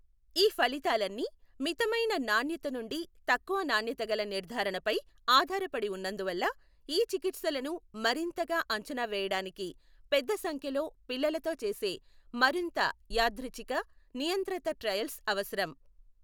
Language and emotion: Telugu, neutral